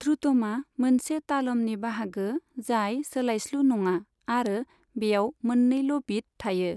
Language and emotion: Bodo, neutral